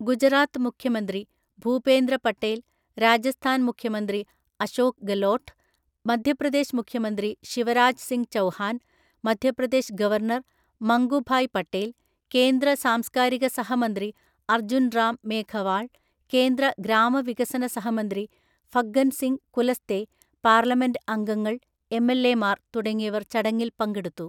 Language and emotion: Malayalam, neutral